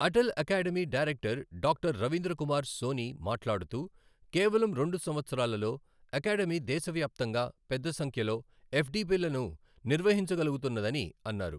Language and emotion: Telugu, neutral